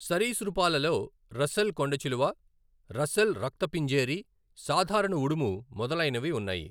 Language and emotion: Telugu, neutral